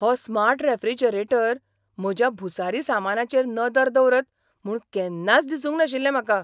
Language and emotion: Goan Konkani, surprised